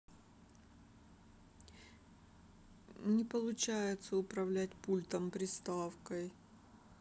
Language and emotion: Russian, sad